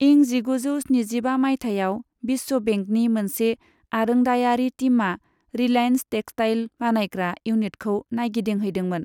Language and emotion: Bodo, neutral